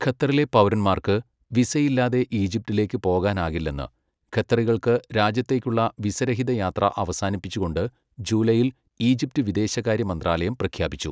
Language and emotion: Malayalam, neutral